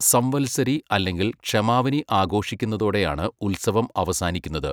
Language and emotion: Malayalam, neutral